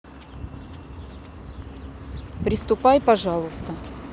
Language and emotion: Russian, neutral